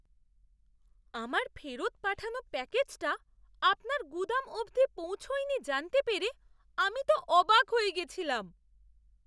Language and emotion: Bengali, surprised